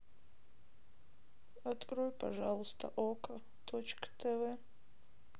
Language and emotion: Russian, sad